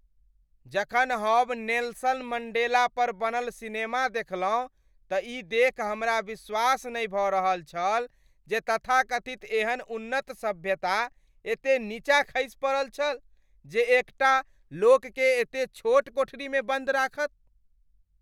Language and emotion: Maithili, disgusted